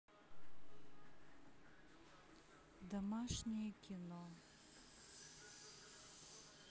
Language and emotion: Russian, sad